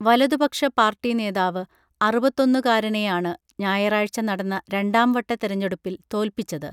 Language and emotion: Malayalam, neutral